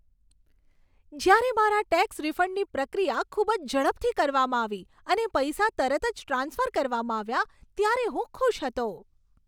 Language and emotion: Gujarati, happy